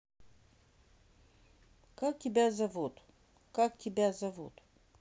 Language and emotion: Russian, neutral